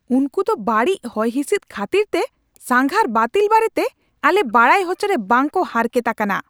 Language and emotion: Santali, angry